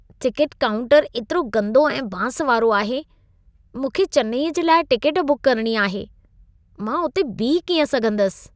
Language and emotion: Sindhi, disgusted